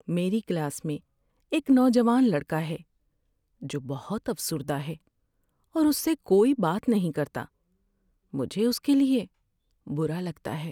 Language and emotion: Urdu, sad